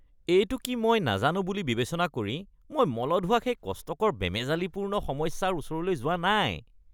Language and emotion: Assamese, disgusted